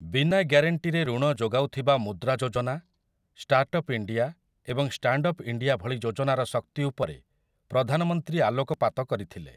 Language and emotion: Odia, neutral